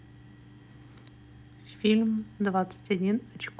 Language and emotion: Russian, neutral